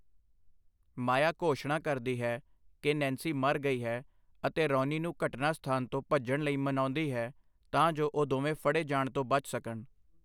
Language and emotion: Punjabi, neutral